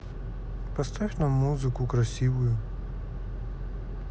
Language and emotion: Russian, neutral